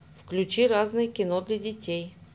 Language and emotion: Russian, neutral